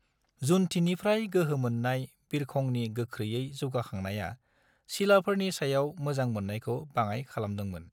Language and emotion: Bodo, neutral